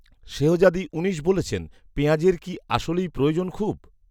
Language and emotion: Bengali, neutral